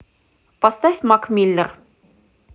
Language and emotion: Russian, neutral